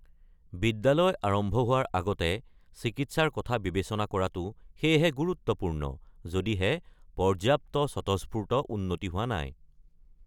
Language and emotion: Assamese, neutral